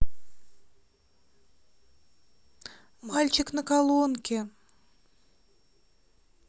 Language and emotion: Russian, positive